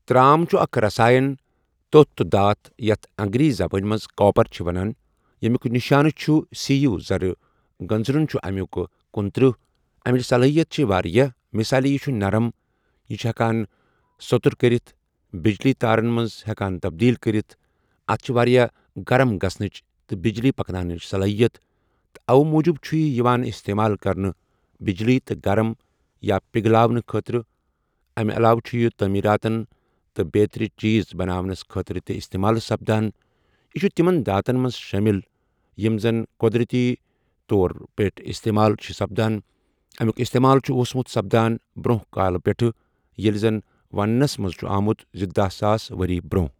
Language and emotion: Kashmiri, neutral